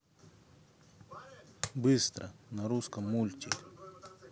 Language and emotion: Russian, neutral